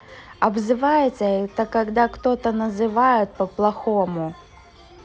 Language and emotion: Russian, neutral